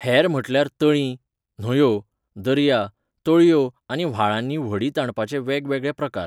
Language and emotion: Goan Konkani, neutral